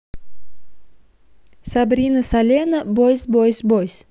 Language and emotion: Russian, neutral